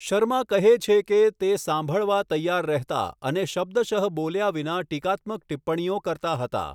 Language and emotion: Gujarati, neutral